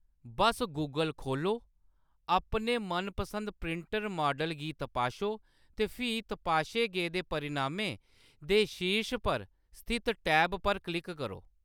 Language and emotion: Dogri, neutral